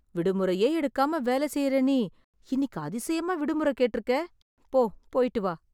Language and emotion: Tamil, surprised